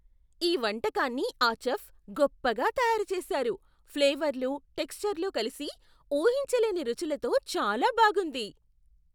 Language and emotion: Telugu, surprised